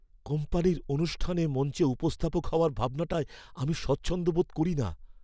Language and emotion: Bengali, fearful